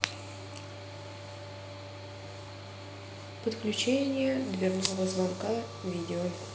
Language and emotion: Russian, neutral